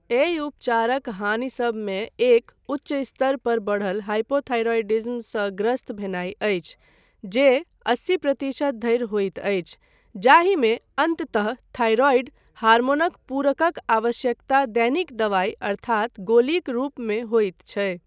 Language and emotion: Maithili, neutral